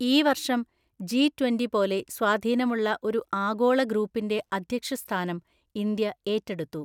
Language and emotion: Malayalam, neutral